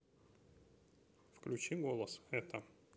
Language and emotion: Russian, neutral